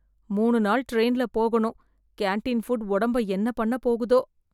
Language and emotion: Tamil, fearful